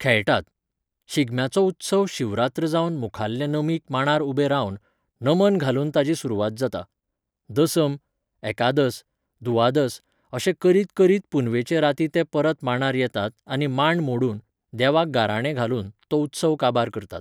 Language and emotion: Goan Konkani, neutral